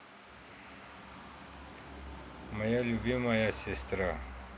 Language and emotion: Russian, neutral